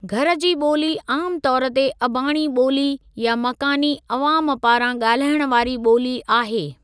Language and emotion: Sindhi, neutral